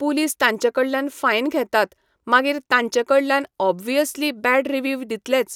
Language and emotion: Goan Konkani, neutral